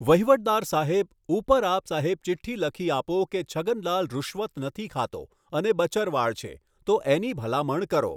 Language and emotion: Gujarati, neutral